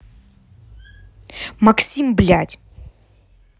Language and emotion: Russian, angry